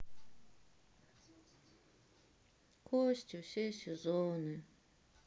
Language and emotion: Russian, sad